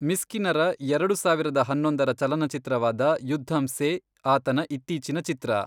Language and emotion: Kannada, neutral